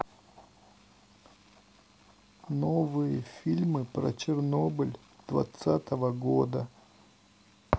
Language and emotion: Russian, neutral